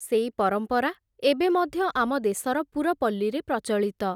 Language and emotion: Odia, neutral